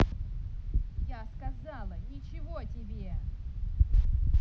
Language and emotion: Russian, angry